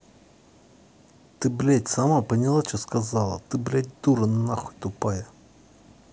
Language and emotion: Russian, angry